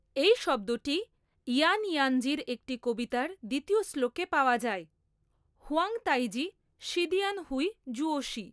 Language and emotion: Bengali, neutral